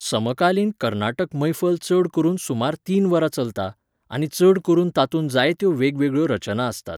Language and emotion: Goan Konkani, neutral